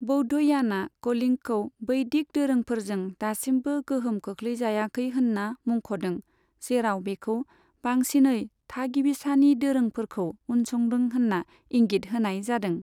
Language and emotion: Bodo, neutral